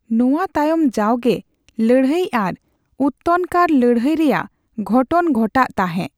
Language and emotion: Santali, neutral